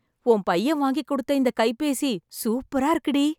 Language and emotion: Tamil, happy